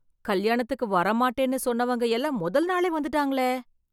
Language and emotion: Tamil, surprised